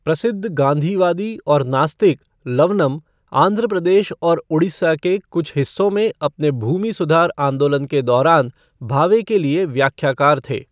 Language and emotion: Hindi, neutral